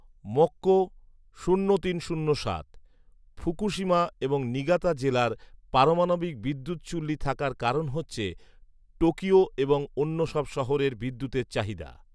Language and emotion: Bengali, neutral